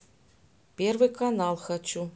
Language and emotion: Russian, neutral